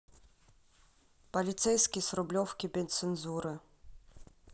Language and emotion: Russian, neutral